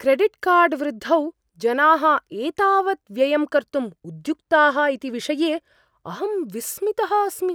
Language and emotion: Sanskrit, surprised